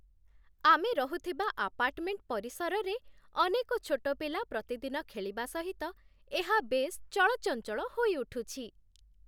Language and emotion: Odia, happy